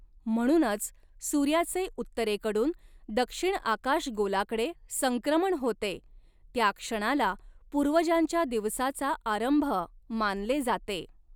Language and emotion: Marathi, neutral